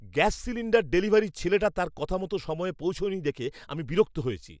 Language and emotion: Bengali, angry